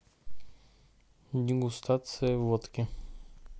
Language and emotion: Russian, neutral